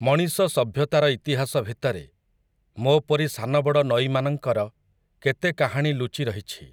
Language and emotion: Odia, neutral